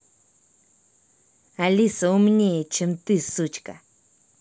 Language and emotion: Russian, angry